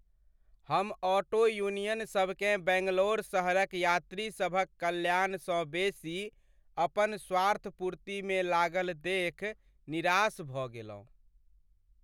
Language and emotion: Maithili, sad